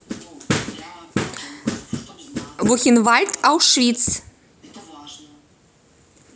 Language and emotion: Russian, positive